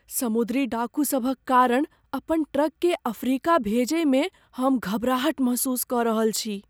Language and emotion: Maithili, fearful